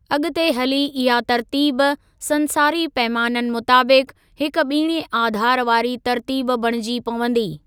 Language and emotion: Sindhi, neutral